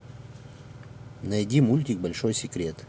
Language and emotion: Russian, neutral